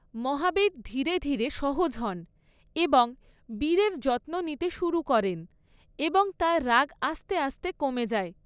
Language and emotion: Bengali, neutral